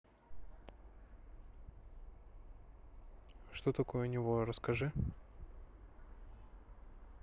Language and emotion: Russian, neutral